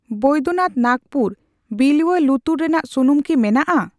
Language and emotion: Santali, neutral